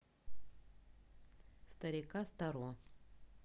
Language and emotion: Russian, neutral